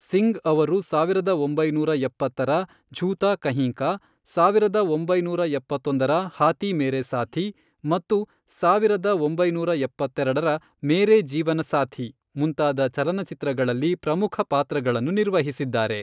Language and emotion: Kannada, neutral